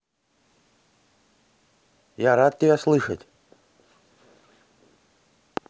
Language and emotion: Russian, neutral